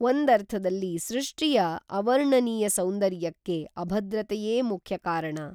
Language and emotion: Kannada, neutral